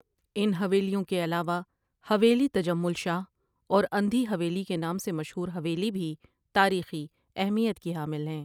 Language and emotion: Urdu, neutral